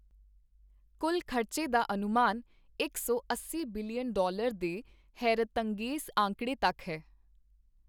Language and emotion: Punjabi, neutral